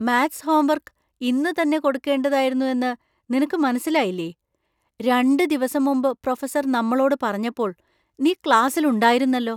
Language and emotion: Malayalam, surprised